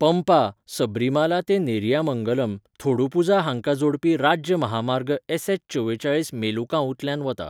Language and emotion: Goan Konkani, neutral